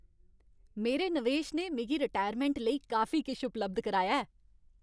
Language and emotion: Dogri, happy